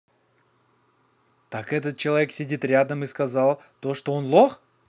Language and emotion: Russian, angry